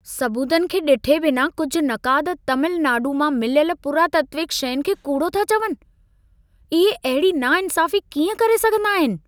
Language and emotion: Sindhi, angry